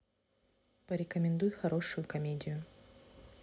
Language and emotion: Russian, neutral